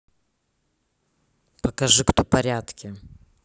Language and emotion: Russian, neutral